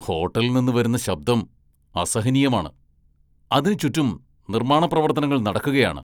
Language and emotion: Malayalam, angry